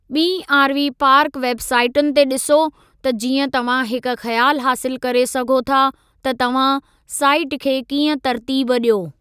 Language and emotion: Sindhi, neutral